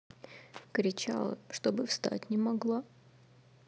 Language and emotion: Russian, sad